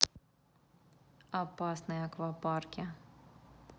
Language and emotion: Russian, neutral